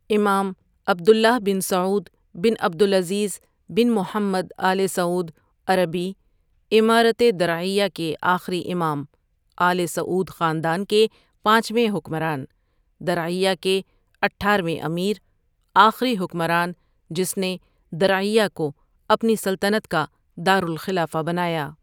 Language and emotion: Urdu, neutral